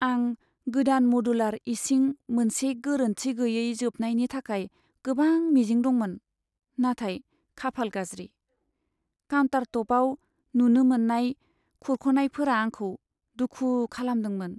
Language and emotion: Bodo, sad